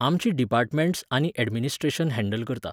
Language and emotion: Goan Konkani, neutral